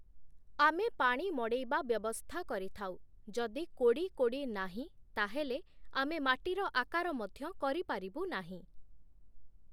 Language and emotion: Odia, neutral